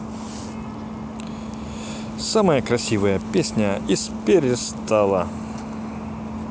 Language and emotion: Russian, positive